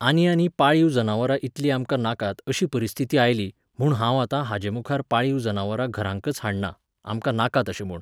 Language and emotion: Goan Konkani, neutral